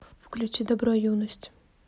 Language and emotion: Russian, neutral